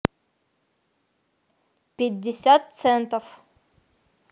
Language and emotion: Russian, neutral